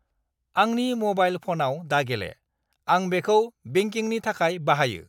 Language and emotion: Bodo, angry